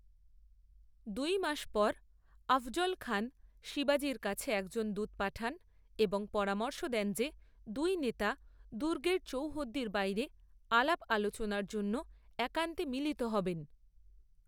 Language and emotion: Bengali, neutral